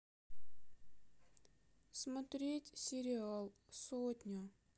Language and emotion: Russian, sad